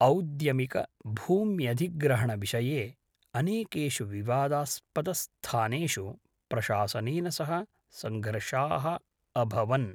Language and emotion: Sanskrit, neutral